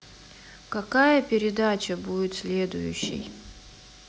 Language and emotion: Russian, neutral